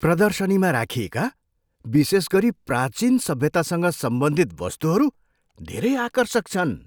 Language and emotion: Nepali, surprised